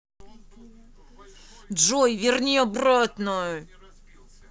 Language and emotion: Russian, angry